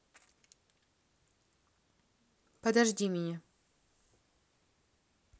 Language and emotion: Russian, neutral